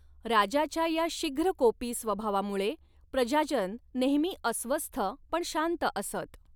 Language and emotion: Marathi, neutral